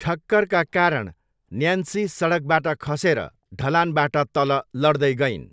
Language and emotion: Nepali, neutral